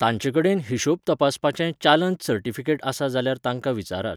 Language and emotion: Goan Konkani, neutral